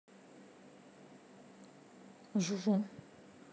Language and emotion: Russian, neutral